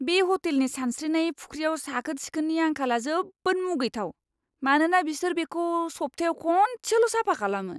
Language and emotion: Bodo, disgusted